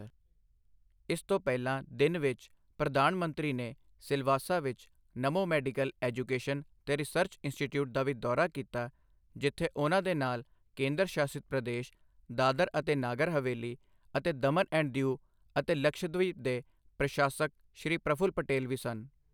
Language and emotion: Punjabi, neutral